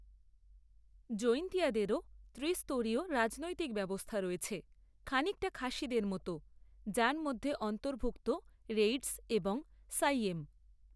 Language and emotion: Bengali, neutral